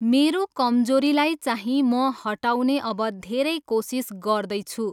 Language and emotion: Nepali, neutral